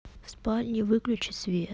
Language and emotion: Russian, neutral